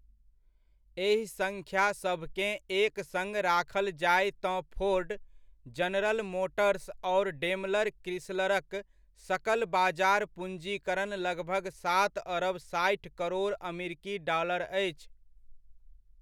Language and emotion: Maithili, neutral